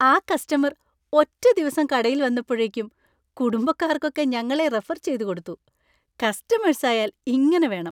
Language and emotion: Malayalam, happy